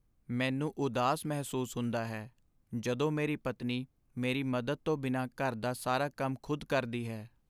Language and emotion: Punjabi, sad